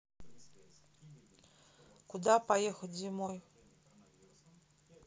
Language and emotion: Russian, neutral